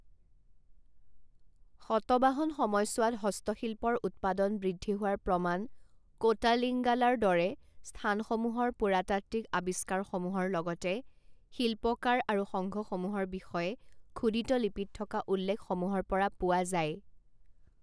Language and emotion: Assamese, neutral